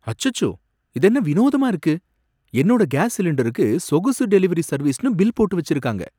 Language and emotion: Tamil, surprised